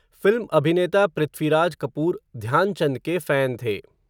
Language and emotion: Hindi, neutral